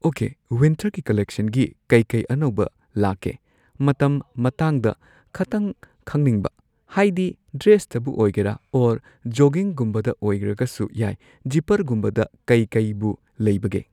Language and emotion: Manipuri, neutral